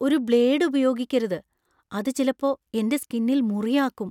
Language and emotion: Malayalam, fearful